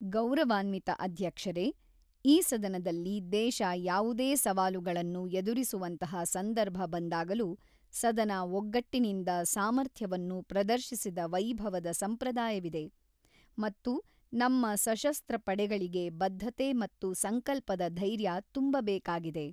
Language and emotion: Kannada, neutral